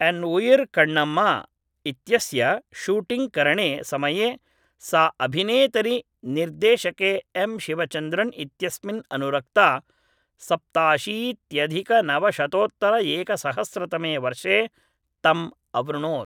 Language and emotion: Sanskrit, neutral